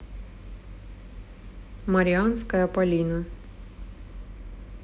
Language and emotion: Russian, neutral